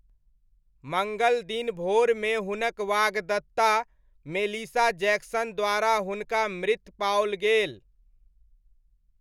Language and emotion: Maithili, neutral